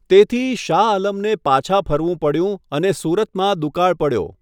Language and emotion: Gujarati, neutral